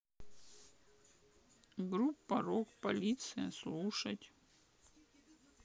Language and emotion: Russian, neutral